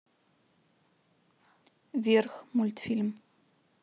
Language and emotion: Russian, neutral